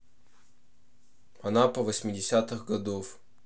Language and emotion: Russian, neutral